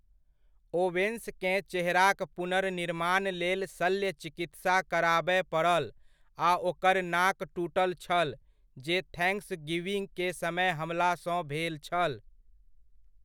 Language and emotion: Maithili, neutral